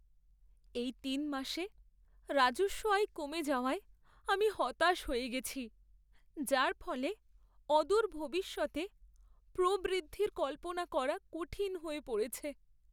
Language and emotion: Bengali, sad